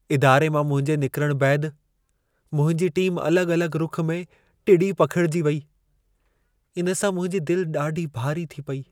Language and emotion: Sindhi, sad